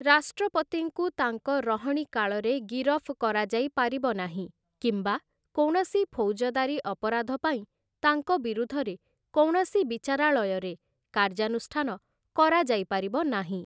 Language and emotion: Odia, neutral